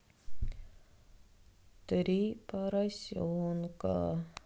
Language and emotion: Russian, sad